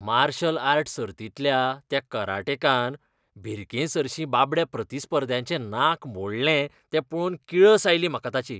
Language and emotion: Goan Konkani, disgusted